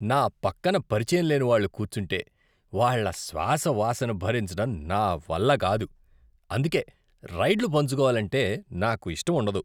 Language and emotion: Telugu, disgusted